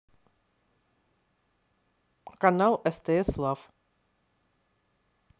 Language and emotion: Russian, neutral